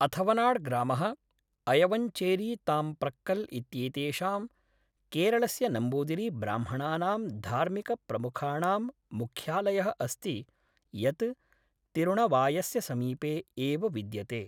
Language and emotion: Sanskrit, neutral